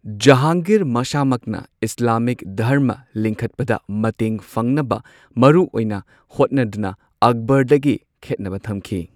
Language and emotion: Manipuri, neutral